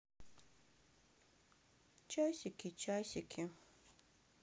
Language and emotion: Russian, sad